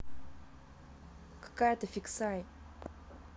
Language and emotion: Russian, angry